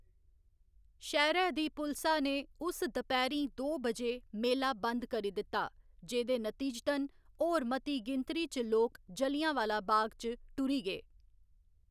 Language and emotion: Dogri, neutral